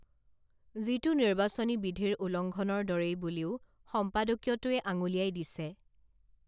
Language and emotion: Assamese, neutral